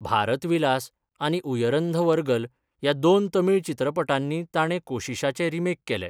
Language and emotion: Goan Konkani, neutral